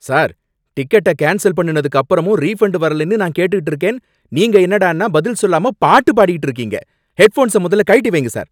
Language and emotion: Tamil, angry